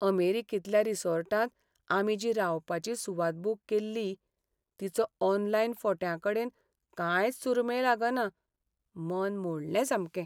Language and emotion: Goan Konkani, sad